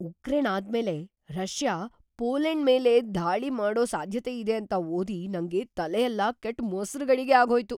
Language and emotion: Kannada, surprised